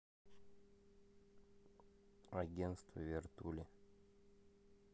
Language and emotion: Russian, neutral